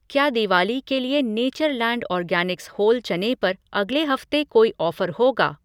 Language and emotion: Hindi, neutral